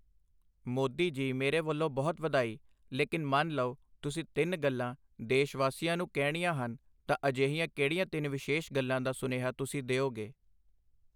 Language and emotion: Punjabi, neutral